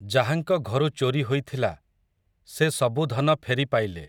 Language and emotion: Odia, neutral